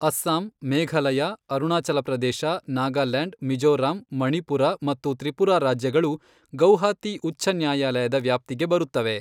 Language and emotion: Kannada, neutral